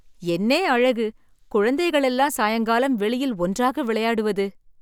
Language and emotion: Tamil, surprised